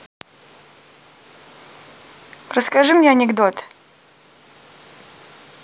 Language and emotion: Russian, neutral